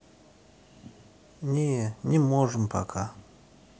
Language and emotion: Russian, sad